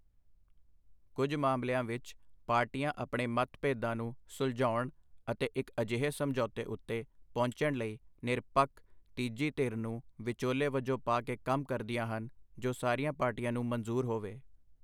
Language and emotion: Punjabi, neutral